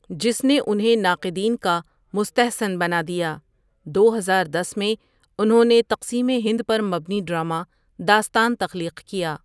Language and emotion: Urdu, neutral